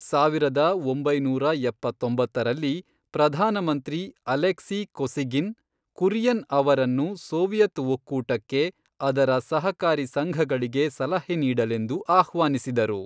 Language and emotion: Kannada, neutral